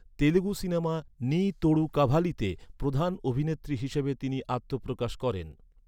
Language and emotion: Bengali, neutral